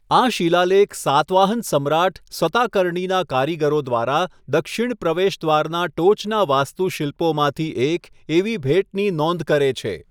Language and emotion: Gujarati, neutral